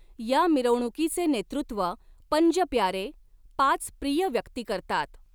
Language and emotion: Marathi, neutral